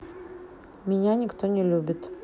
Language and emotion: Russian, sad